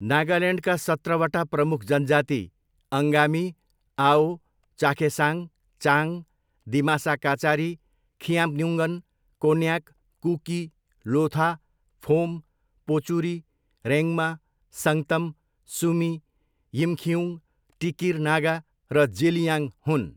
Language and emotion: Nepali, neutral